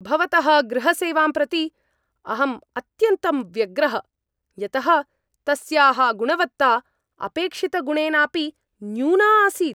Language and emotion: Sanskrit, angry